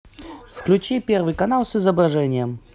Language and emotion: Russian, positive